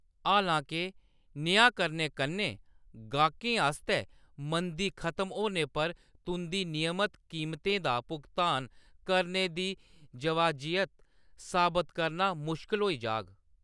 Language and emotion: Dogri, neutral